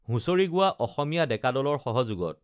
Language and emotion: Assamese, neutral